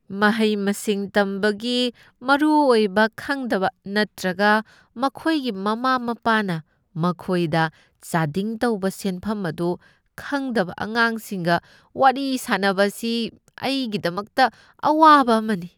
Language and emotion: Manipuri, disgusted